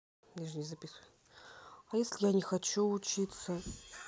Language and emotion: Russian, sad